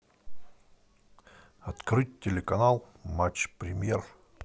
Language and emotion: Russian, neutral